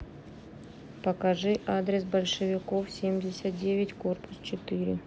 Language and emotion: Russian, neutral